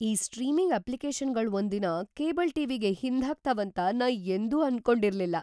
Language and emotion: Kannada, surprised